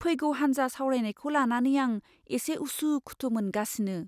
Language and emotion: Bodo, fearful